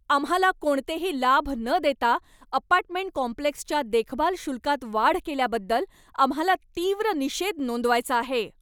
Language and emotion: Marathi, angry